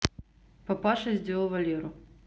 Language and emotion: Russian, neutral